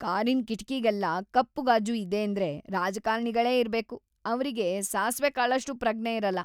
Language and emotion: Kannada, disgusted